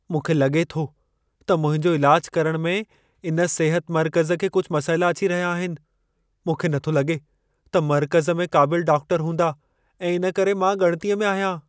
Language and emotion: Sindhi, fearful